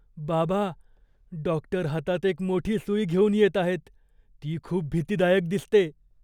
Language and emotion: Marathi, fearful